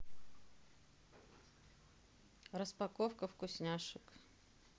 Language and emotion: Russian, neutral